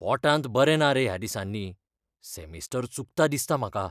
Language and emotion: Goan Konkani, fearful